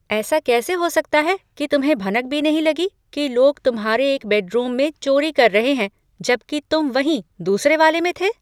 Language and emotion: Hindi, surprised